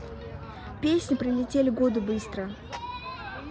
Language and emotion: Russian, neutral